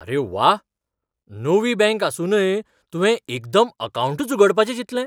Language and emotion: Goan Konkani, surprised